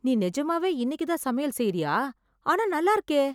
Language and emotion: Tamil, surprised